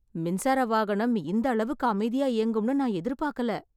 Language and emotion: Tamil, surprised